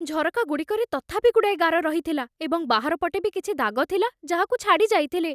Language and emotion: Odia, fearful